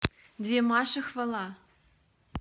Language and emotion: Russian, positive